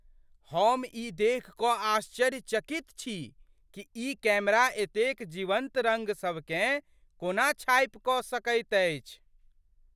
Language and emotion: Maithili, surprised